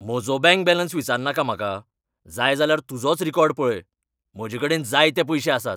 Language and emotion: Goan Konkani, angry